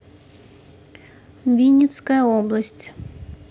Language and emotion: Russian, neutral